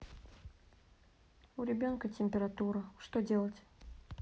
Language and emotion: Russian, sad